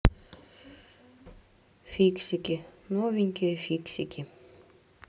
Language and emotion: Russian, neutral